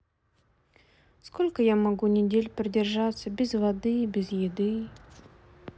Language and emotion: Russian, sad